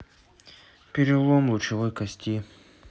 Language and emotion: Russian, neutral